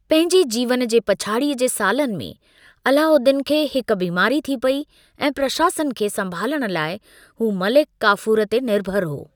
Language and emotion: Sindhi, neutral